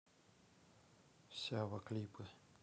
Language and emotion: Russian, neutral